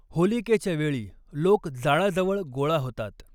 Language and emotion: Marathi, neutral